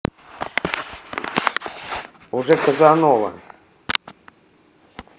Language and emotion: Russian, neutral